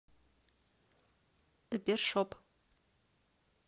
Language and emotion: Russian, neutral